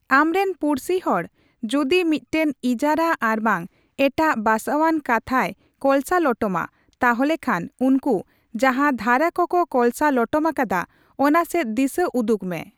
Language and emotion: Santali, neutral